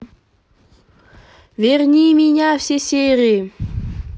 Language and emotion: Russian, positive